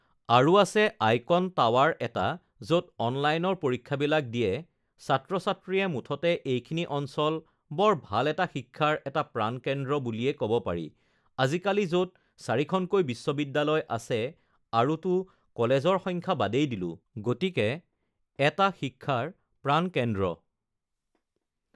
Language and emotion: Assamese, neutral